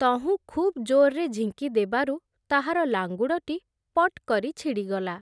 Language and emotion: Odia, neutral